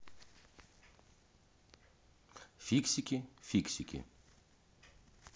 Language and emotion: Russian, neutral